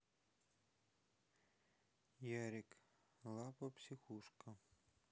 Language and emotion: Russian, sad